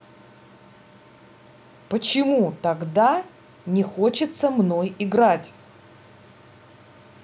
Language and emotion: Russian, angry